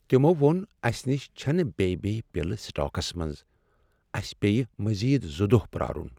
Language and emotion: Kashmiri, sad